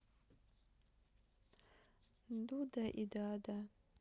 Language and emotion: Russian, sad